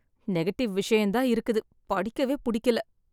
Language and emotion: Tamil, sad